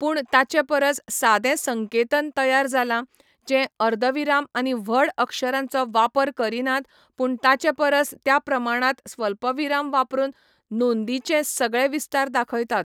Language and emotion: Goan Konkani, neutral